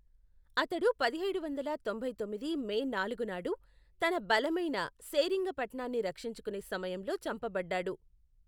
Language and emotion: Telugu, neutral